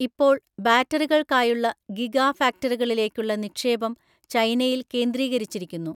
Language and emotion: Malayalam, neutral